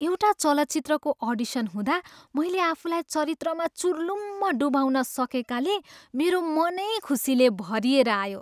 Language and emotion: Nepali, happy